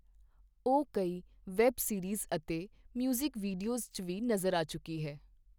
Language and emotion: Punjabi, neutral